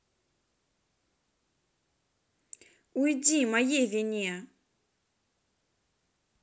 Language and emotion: Russian, angry